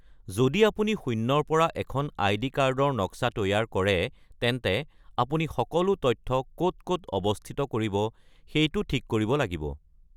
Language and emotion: Assamese, neutral